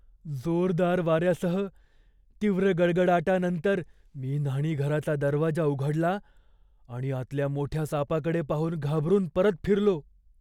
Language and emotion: Marathi, fearful